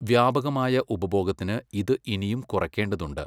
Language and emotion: Malayalam, neutral